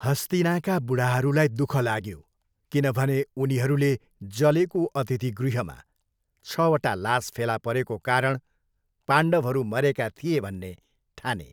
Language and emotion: Nepali, neutral